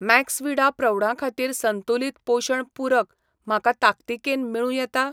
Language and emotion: Goan Konkani, neutral